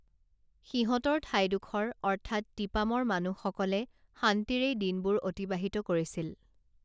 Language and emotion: Assamese, neutral